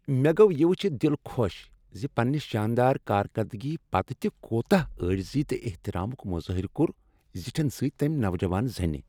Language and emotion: Kashmiri, happy